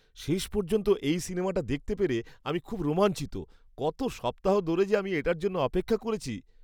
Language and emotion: Bengali, happy